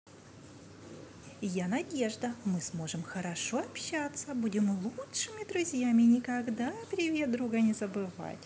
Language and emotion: Russian, positive